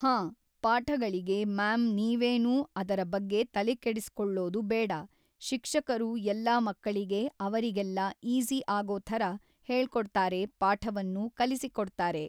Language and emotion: Kannada, neutral